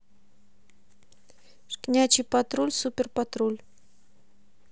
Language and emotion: Russian, neutral